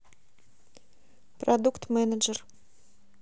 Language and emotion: Russian, neutral